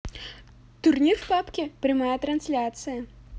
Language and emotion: Russian, positive